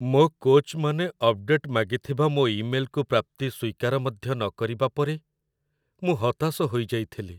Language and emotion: Odia, sad